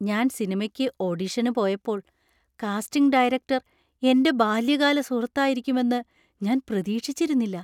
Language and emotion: Malayalam, surprised